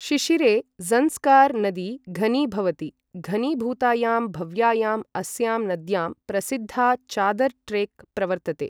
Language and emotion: Sanskrit, neutral